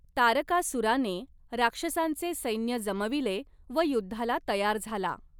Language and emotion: Marathi, neutral